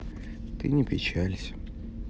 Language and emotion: Russian, sad